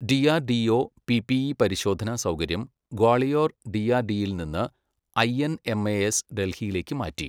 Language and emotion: Malayalam, neutral